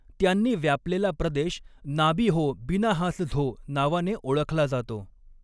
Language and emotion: Marathi, neutral